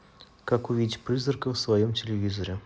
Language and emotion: Russian, neutral